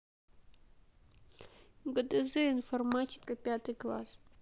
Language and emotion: Russian, sad